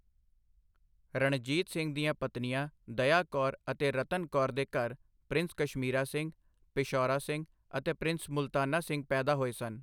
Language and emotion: Punjabi, neutral